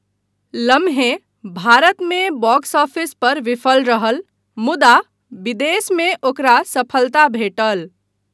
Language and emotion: Maithili, neutral